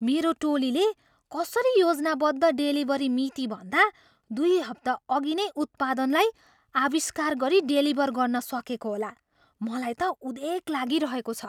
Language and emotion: Nepali, surprised